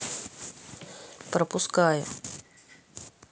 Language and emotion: Russian, neutral